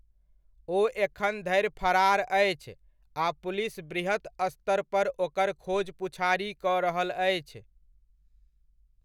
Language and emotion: Maithili, neutral